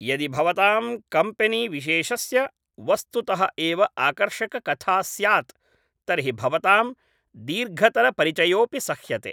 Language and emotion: Sanskrit, neutral